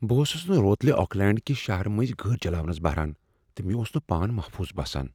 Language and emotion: Kashmiri, fearful